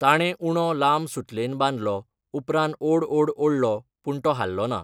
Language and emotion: Goan Konkani, neutral